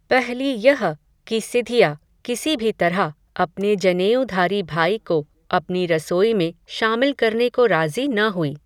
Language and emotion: Hindi, neutral